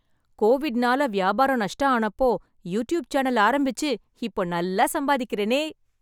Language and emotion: Tamil, happy